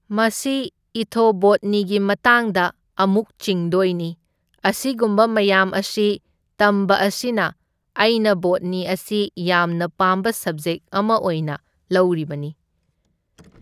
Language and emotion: Manipuri, neutral